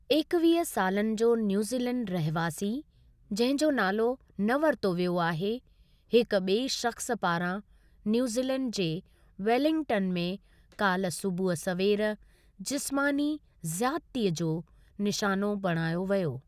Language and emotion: Sindhi, neutral